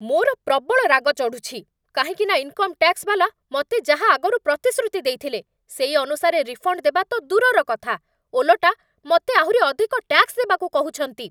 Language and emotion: Odia, angry